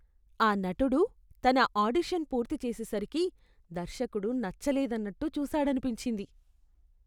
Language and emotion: Telugu, disgusted